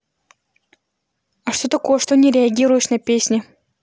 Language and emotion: Russian, angry